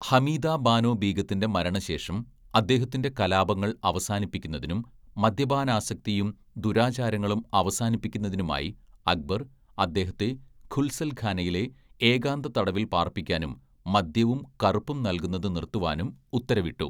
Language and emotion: Malayalam, neutral